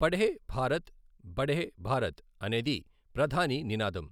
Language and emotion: Telugu, neutral